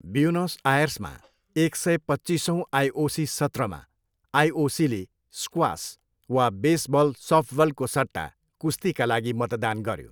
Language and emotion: Nepali, neutral